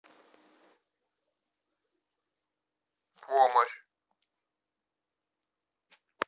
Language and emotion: Russian, neutral